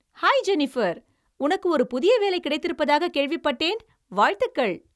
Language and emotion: Tamil, happy